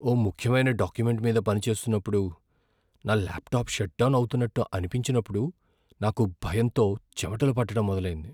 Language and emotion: Telugu, fearful